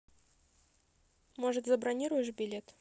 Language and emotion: Russian, neutral